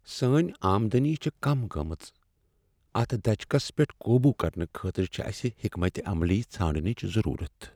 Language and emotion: Kashmiri, sad